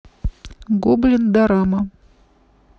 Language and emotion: Russian, neutral